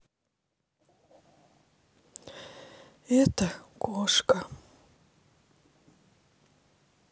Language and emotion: Russian, sad